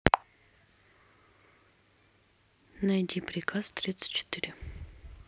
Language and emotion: Russian, neutral